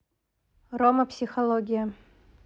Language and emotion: Russian, neutral